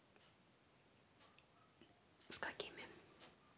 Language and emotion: Russian, neutral